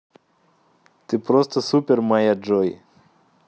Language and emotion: Russian, positive